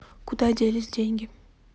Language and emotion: Russian, neutral